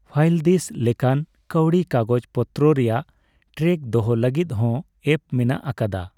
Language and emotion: Santali, neutral